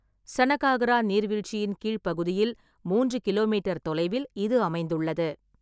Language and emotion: Tamil, neutral